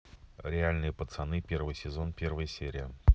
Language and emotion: Russian, neutral